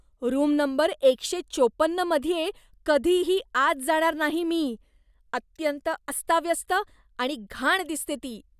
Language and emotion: Marathi, disgusted